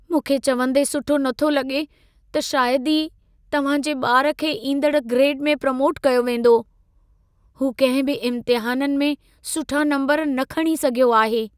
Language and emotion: Sindhi, sad